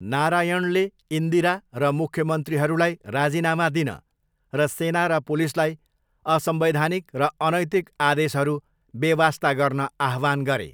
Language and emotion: Nepali, neutral